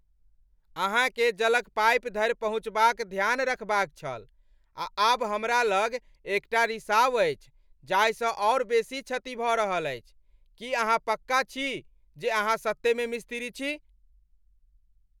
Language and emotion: Maithili, angry